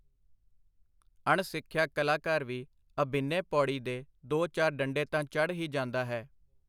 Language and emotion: Punjabi, neutral